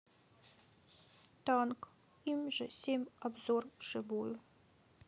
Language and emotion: Russian, sad